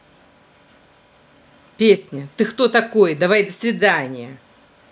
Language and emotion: Russian, angry